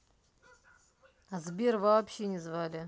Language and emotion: Russian, angry